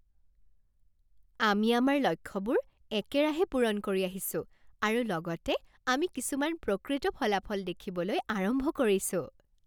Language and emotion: Assamese, happy